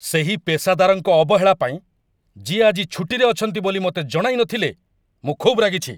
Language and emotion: Odia, angry